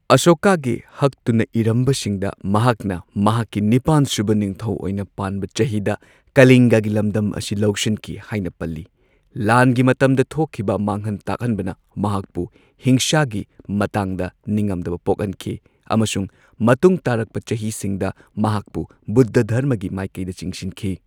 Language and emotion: Manipuri, neutral